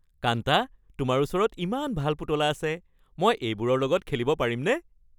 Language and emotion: Assamese, happy